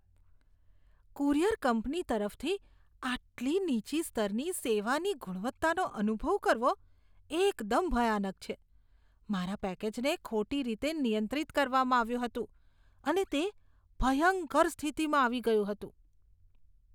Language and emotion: Gujarati, disgusted